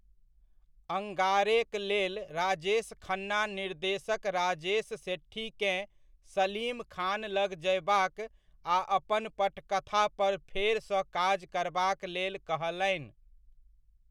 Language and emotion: Maithili, neutral